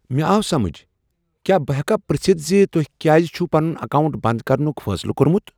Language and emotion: Kashmiri, surprised